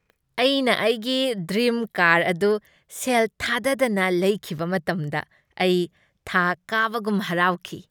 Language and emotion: Manipuri, happy